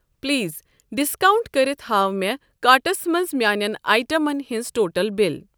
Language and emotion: Kashmiri, neutral